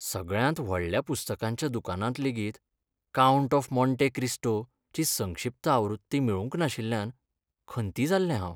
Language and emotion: Goan Konkani, sad